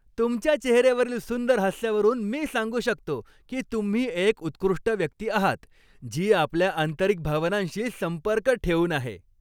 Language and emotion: Marathi, happy